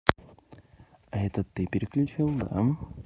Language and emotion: Russian, neutral